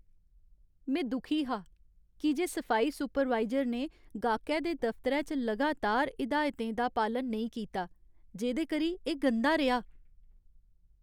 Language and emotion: Dogri, sad